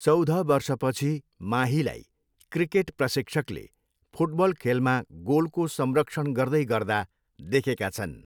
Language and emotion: Nepali, neutral